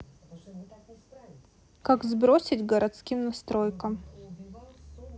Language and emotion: Russian, neutral